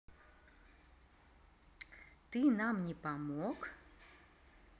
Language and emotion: Russian, neutral